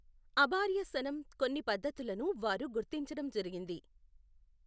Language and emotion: Telugu, neutral